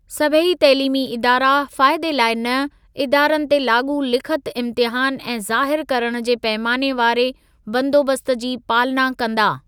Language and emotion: Sindhi, neutral